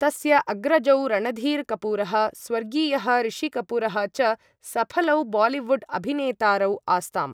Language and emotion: Sanskrit, neutral